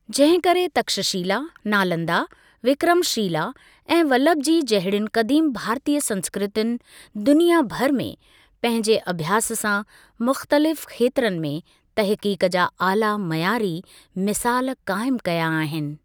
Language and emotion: Sindhi, neutral